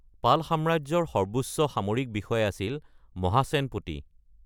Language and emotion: Assamese, neutral